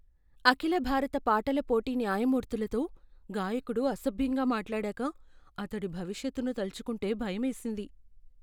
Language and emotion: Telugu, fearful